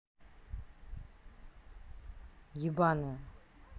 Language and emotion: Russian, angry